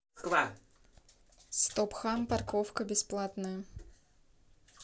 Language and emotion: Russian, neutral